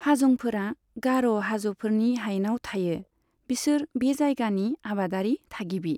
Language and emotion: Bodo, neutral